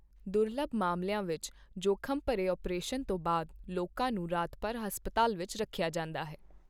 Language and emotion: Punjabi, neutral